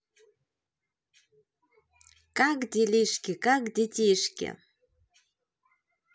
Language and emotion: Russian, positive